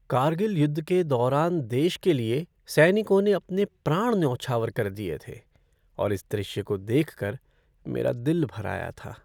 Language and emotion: Hindi, sad